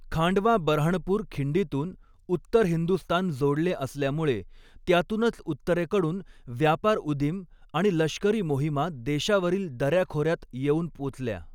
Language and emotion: Marathi, neutral